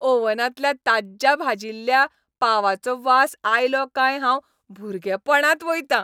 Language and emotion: Goan Konkani, happy